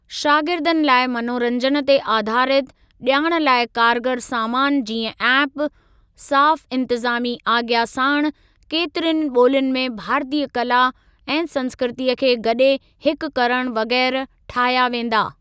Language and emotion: Sindhi, neutral